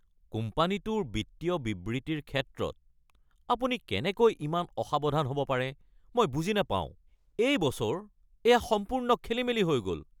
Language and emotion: Assamese, angry